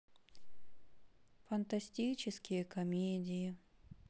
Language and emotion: Russian, sad